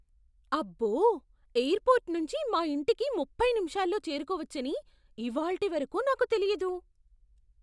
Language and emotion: Telugu, surprised